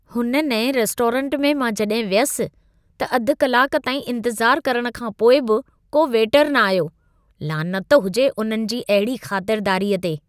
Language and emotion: Sindhi, disgusted